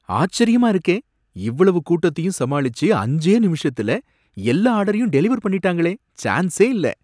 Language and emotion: Tamil, surprised